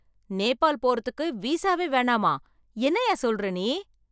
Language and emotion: Tamil, surprised